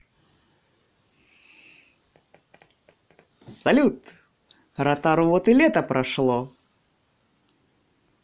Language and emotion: Russian, positive